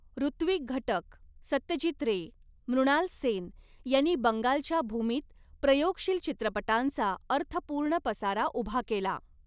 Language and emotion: Marathi, neutral